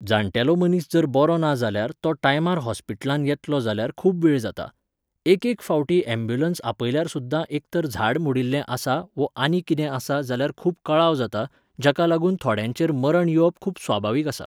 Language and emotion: Goan Konkani, neutral